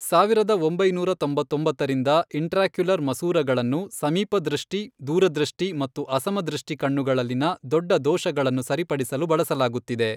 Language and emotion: Kannada, neutral